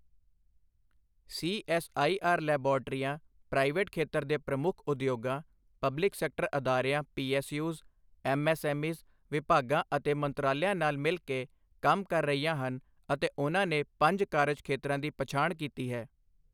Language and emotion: Punjabi, neutral